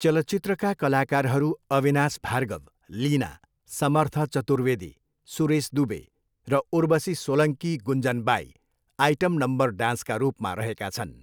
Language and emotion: Nepali, neutral